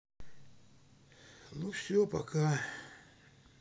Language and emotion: Russian, sad